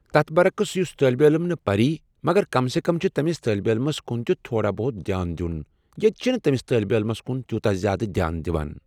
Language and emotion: Kashmiri, neutral